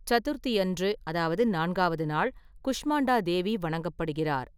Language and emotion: Tamil, neutral